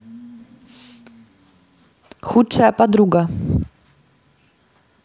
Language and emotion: Russian, neutral